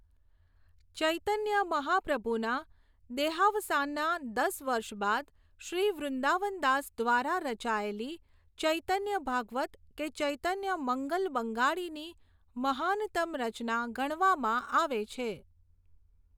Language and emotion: Gujarati, neutral